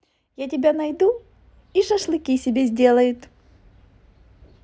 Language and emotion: Russian, positive